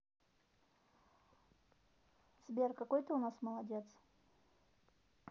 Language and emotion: Russian, neutral